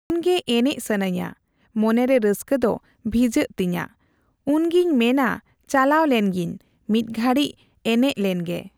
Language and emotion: Santali, neutral